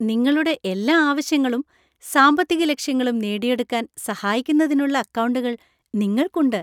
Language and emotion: Malayalam, happy